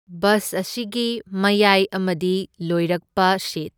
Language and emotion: Manipuri, neutral